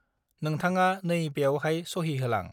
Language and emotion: Bodo, neutral